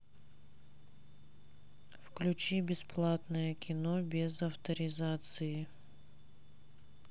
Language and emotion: Russian, neutral